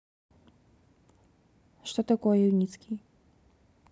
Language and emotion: Russian, neutral